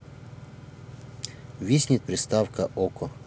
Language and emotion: Russian, neutral